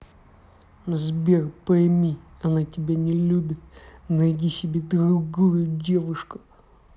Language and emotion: Russian, angry